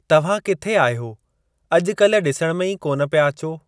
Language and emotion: Sindhi, neutral